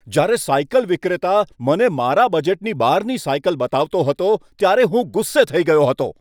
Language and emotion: Gujarati, angry